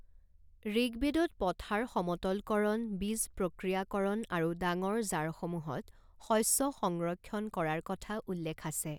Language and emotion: Assamese, neutral